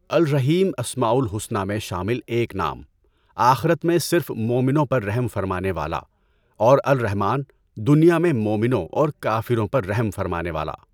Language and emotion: Urdu, neutral